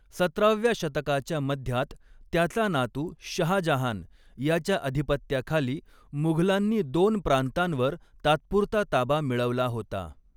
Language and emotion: Marathi, neutral